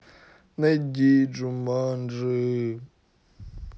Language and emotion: Russian, sad